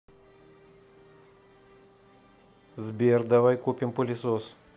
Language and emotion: Russian, neutral